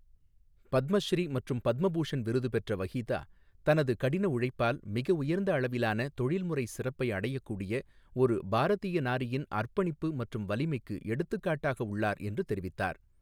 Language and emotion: Tamil, neutral